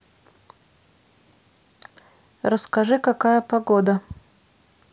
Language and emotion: Russian, neutral